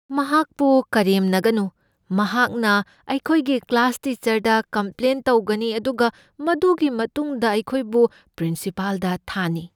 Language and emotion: Manipuri, fearful